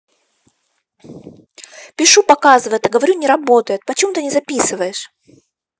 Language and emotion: Russian, angry